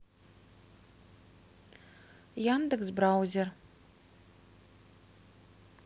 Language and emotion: Russian, neutral